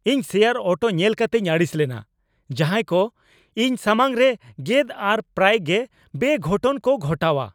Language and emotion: Santali, angry